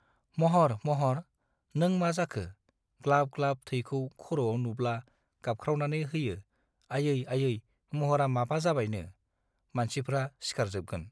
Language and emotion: Bodo, neutral